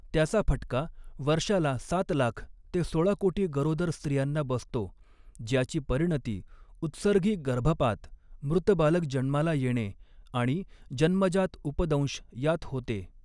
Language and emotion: Marathi, neutral